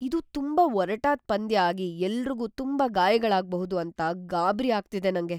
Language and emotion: Kannada, fearful